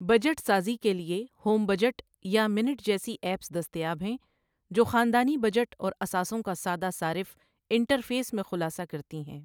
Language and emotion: Urdu, neutral